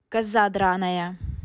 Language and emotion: Russian, angry